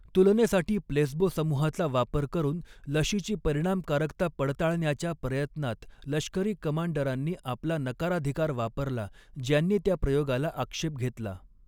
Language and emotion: Marathi, neutral